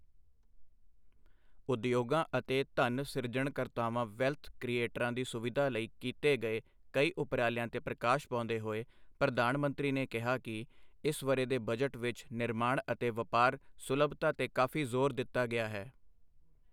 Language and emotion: Punjabi, neutral